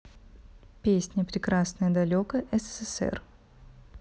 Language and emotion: Russian, neutral